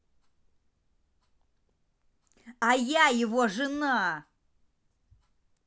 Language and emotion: Russian, angry